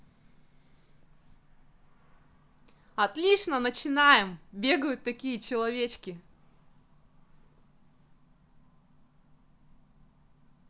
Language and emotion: Russian, positive